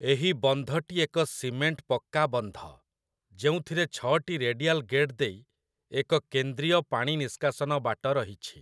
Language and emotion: Odia, neutral